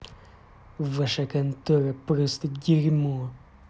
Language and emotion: Russian, angry